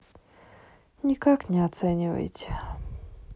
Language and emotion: Russian, sad